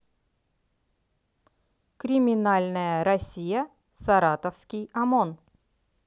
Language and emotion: Russian, positive